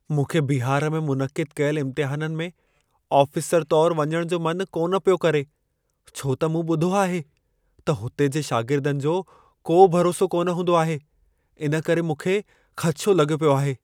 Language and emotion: Sindhi, fearful